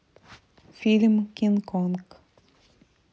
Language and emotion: Russian, neutral